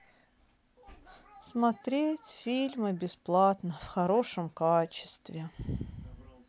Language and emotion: Russian, sad